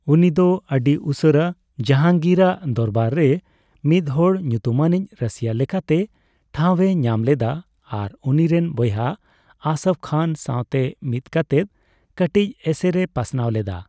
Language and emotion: Santali, neutral